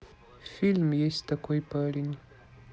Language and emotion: Russian, neutral